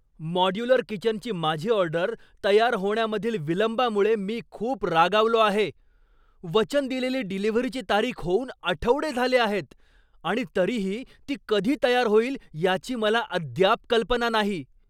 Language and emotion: Marathi, angry